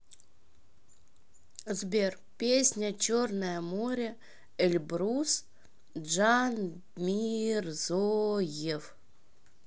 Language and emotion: Russian, neutral